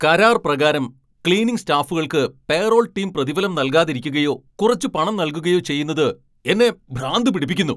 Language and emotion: Malayalam, angry